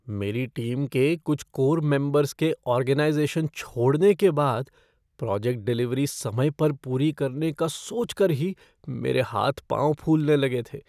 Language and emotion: Hindi, fearful